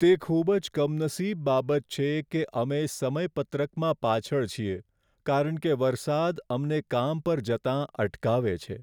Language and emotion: Gujarati, sad